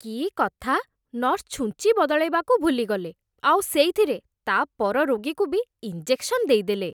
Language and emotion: Odia, disgusted